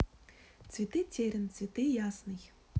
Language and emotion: Russian, neutral